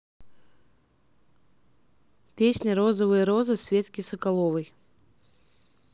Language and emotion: Russian, neutral